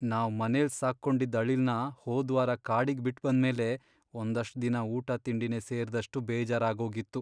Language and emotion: Kannada, sad